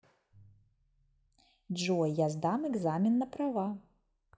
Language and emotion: Russian, positive